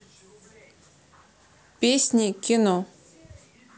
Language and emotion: Russian, neutral